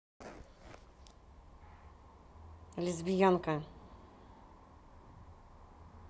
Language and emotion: Russian, neutral